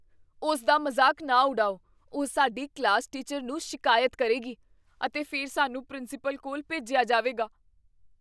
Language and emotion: Punjabi, fearful